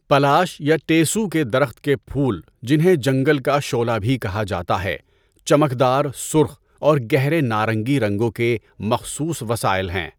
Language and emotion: Urdu, neutral